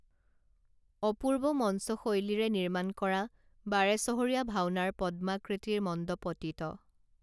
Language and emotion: Assamese, neutral